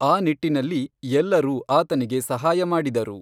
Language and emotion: Kannada, neutral